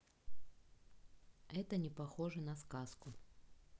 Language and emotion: Russian, neutral